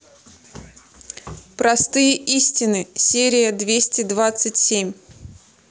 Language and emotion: Russian, neutral